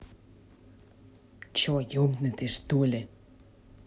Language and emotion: Russian, angry